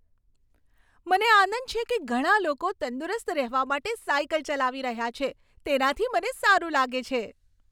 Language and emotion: Gujarati, happy